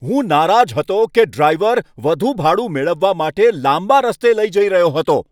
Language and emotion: Gujarati, angry